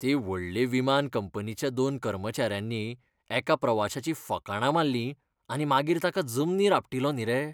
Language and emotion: Goan Konkani, disgusted